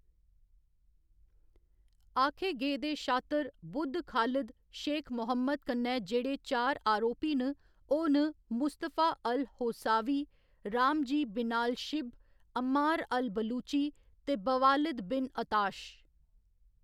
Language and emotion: Dogri, neutral